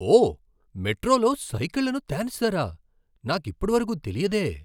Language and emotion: Telugu, surprised